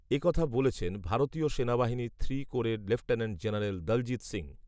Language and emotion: Bengali, neutral